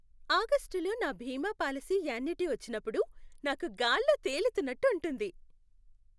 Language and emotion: Telugu, happy